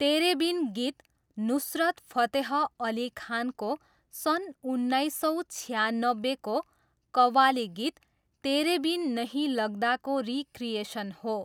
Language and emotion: Nepali, neutral